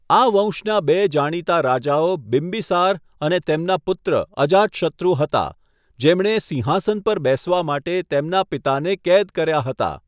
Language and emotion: Gujarati, neutral